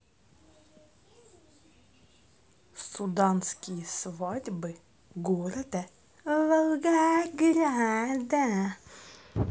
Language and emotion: Russian, neutral